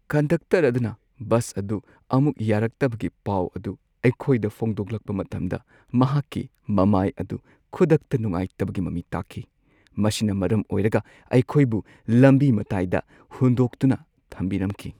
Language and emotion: Manipuri, sad